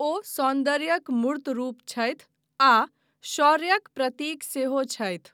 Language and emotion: Maithili, neutral